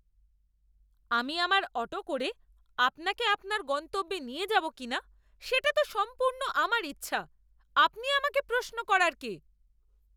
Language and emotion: Bengali, angry